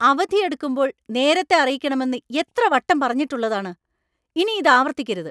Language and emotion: Malayalam, angry